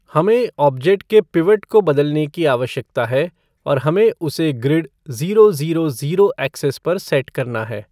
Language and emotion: Hindi, neutral